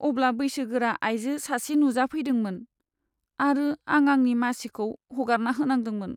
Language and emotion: Bodo, sad